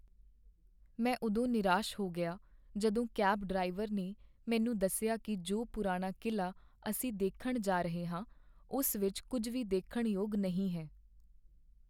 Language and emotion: Punjabi, sad